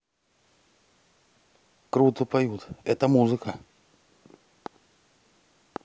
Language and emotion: Russian, positive